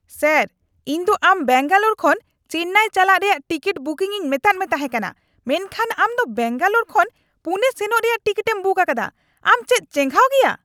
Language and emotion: Santali, angry